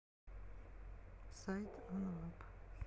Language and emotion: Russian, sad